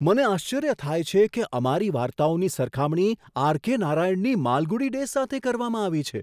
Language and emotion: Gujarati, surprised